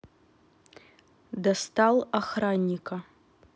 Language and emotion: Russian, neutral